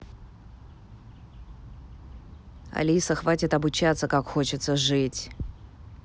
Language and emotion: Russian, angry